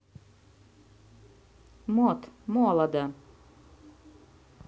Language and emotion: Russian, neutral